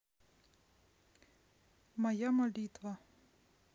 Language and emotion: Russian, neutral